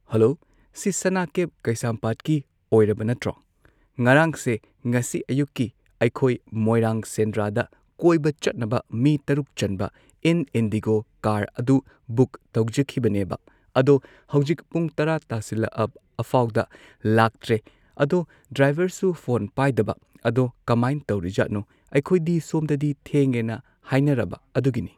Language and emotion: Manipuri, neutral